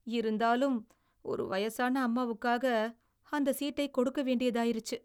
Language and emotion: Tamil, sad